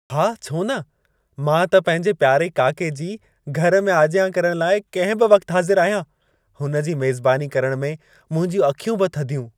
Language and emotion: Sindhi, happy